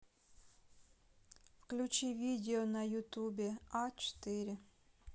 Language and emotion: Russian, neutral